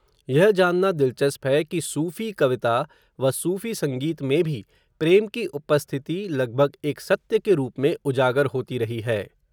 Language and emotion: Hindi, neutral